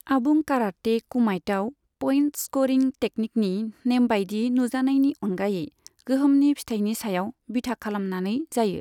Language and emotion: Bodo, neutral